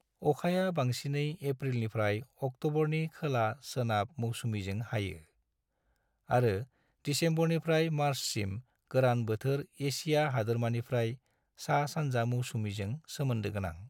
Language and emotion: Bodo, neutral